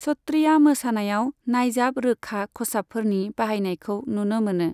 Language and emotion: Bodo, neutral